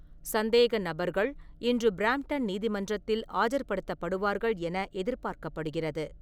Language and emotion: Tamil, neutral